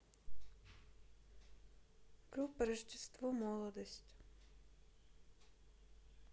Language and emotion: Russian, neutral